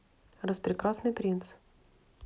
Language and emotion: Russian, neutral